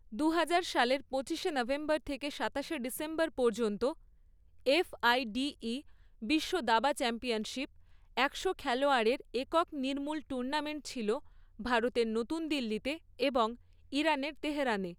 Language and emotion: Bengali, neutral